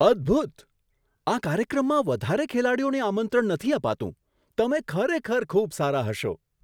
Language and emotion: Gujarati, surprised